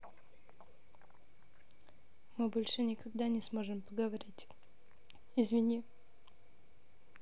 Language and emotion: Russian, sad